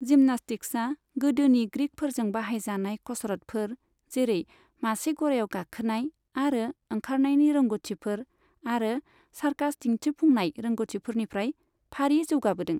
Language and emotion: Bodo, neutral